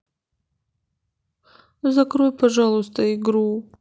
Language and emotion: Russian, sad